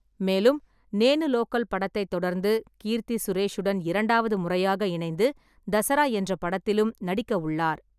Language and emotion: Tamil, neutral